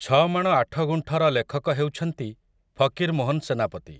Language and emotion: Odia, neutral